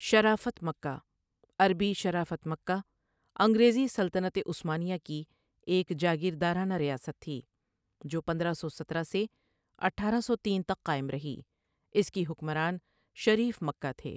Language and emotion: Urdu, neutral